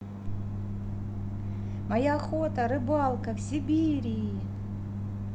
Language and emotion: Russian, positive